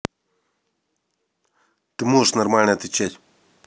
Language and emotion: Russian, angry